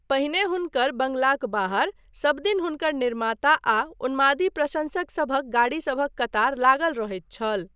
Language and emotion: Maithili, neutral